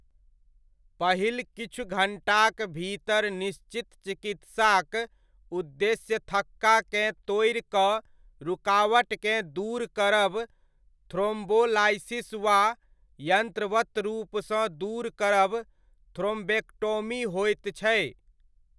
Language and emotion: Maithili, neutral